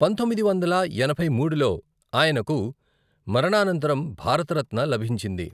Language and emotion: Telugu, neutral